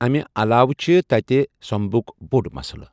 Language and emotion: Kashmiri, neutral